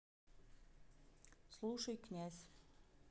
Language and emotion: Russian, neutral